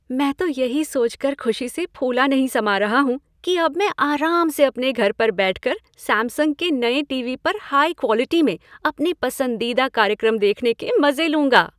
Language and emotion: Hindi, happy